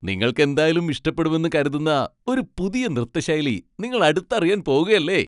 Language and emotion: Malayalam, happy